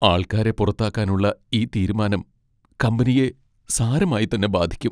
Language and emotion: Malayalam, sad